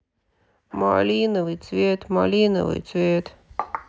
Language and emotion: Russian, sad